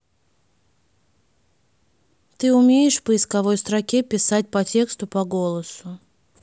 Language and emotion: Russian, neutral